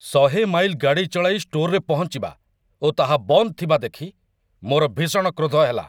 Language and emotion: Odia, angry